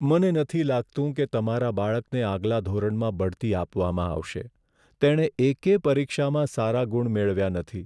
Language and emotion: Gujarati, sad